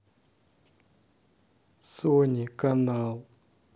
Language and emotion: Russian, sad